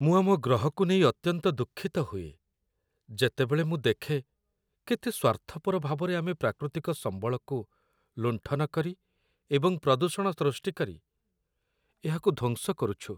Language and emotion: Odia, sad